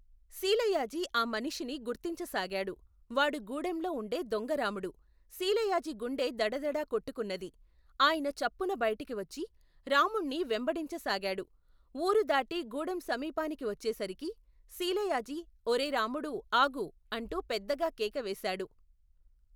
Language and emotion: Telugu, neutral